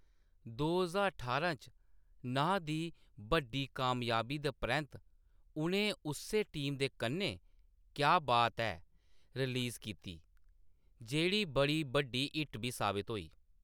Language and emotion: Dogri, neutral